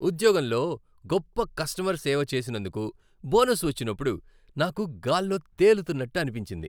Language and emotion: Telugu, happy